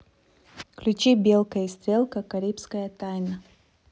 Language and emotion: Russian, neutral